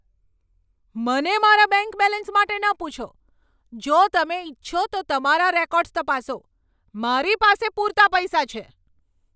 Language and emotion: Gujarati, angry